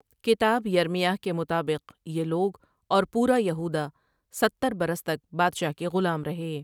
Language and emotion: Urdu, neutral